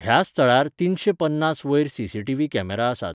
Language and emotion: Goan Konkani, neutral